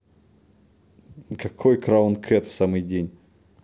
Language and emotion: Russian, neutral